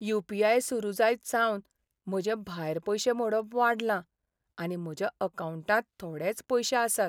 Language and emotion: Goan Konkani, sad